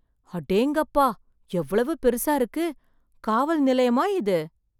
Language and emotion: Tamil, surprised